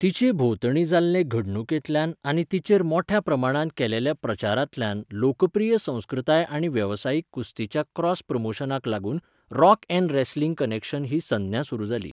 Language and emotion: Goan Konkani, neutral